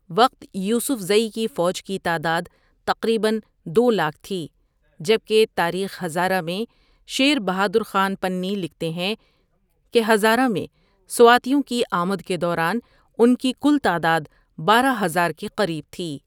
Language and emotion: Urdu, neutral